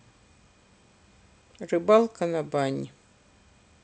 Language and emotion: Russian, neutral